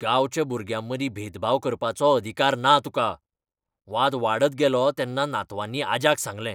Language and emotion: Goan Konkani, angry